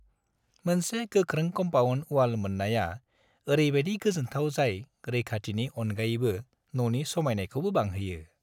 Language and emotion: Bodo, happy